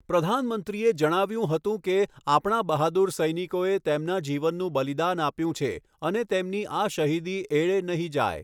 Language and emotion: Gujarati, neutral